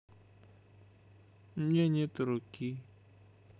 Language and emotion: Russian, sad